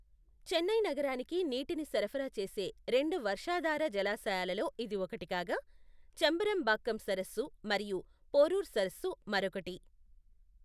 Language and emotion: Telugu, neutral